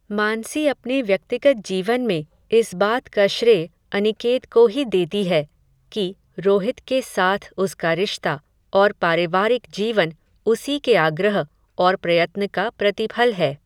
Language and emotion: Hindi, neutral